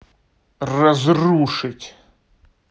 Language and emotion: Russian, angry